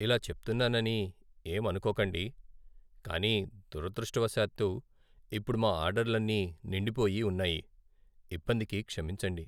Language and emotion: Telugu, sad